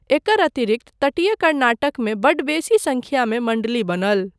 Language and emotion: Maithili, neutral